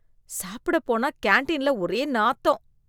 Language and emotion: Tamil, disgusted